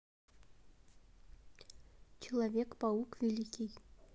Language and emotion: Russian, neutral